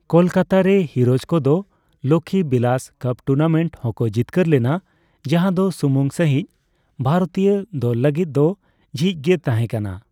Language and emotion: Santali, neutral